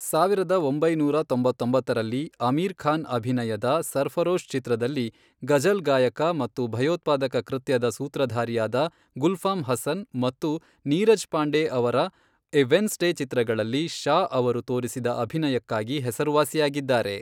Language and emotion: Kannada, neutral